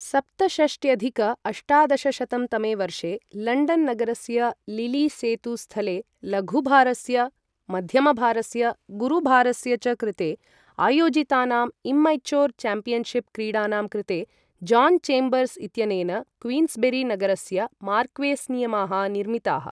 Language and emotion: Sanskrit, neutral